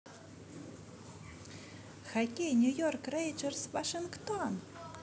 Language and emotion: Russian, positive